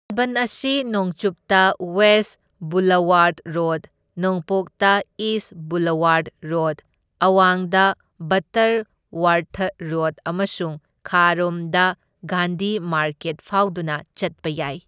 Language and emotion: Manipuri, neutral